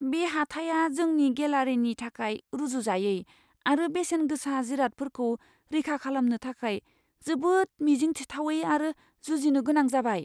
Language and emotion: Bodo, fearful